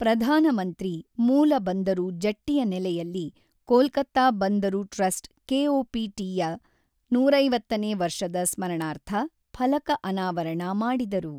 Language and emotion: Kannada, neutral